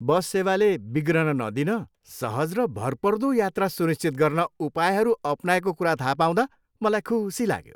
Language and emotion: Nepali, happy